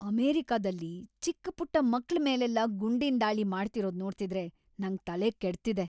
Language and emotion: Kannada, angry